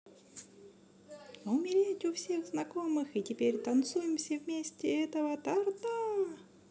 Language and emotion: Russian, positive